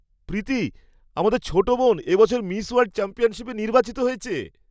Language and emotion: Bengali, surprised